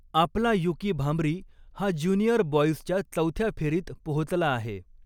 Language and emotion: Marathi, neutral